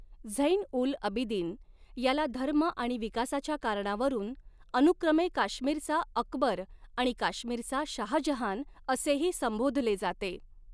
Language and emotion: Marathi, neutral